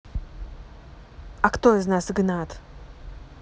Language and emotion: Russian, neutral